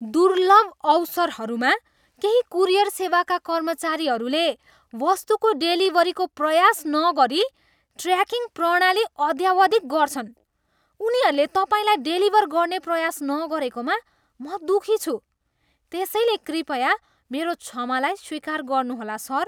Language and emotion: Nepali, disgusted